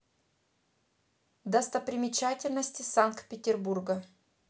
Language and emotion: Russian, neutral